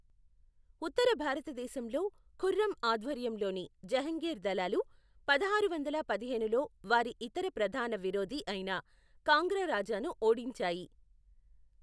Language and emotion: Telugu, neutral